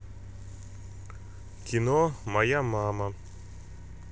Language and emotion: Russian, neutral